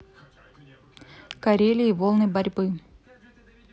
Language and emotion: Russian, neutral